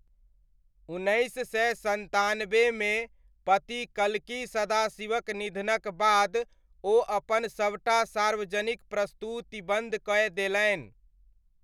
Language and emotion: Maithili, neutral